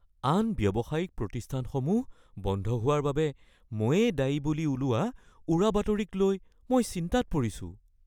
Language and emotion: Assamese, fearful